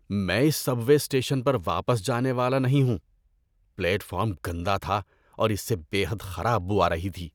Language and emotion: Urdu, disgusted